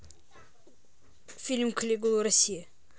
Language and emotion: Russian, neutral